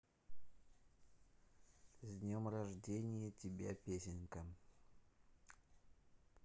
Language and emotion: Russian, neutral